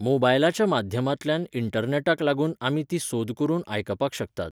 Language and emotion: Goan Konkani, neutral